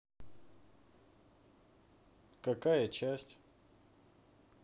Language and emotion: Russian, neutral